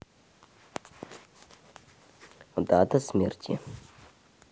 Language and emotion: Russian, neutral